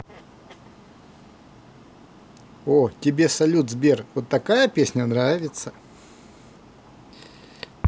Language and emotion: Russian, positive